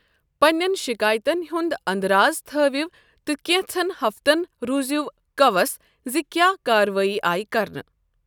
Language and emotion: Kashmiri, neutral